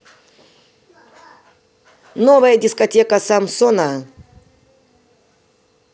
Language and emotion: Russian, positive